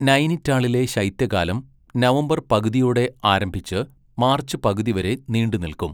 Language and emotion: Malayalam, neutral